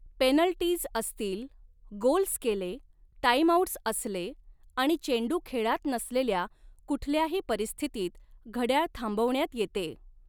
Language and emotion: Marathi, neutral